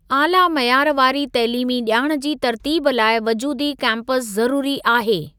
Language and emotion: Sindhi, neutral